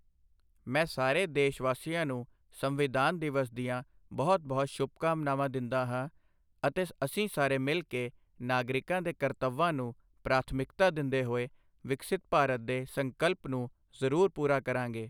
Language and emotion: Punjabi, neutral